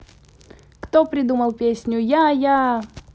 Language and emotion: Russian, positive